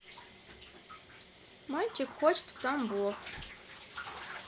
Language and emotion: Russian, neutral